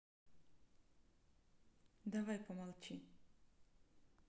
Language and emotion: Russian, neutral